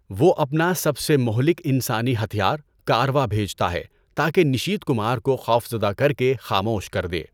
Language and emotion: Urdu, neutral